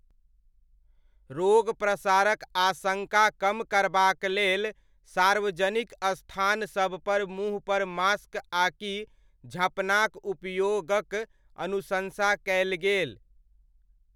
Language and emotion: Maithili, neutral